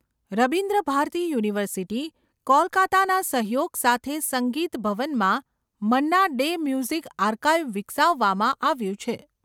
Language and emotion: Gujarati, neutral